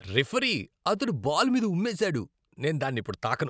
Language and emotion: Telugu, disgusted